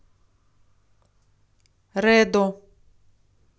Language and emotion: Russian, neutral